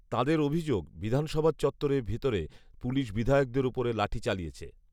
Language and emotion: Bengali, neutral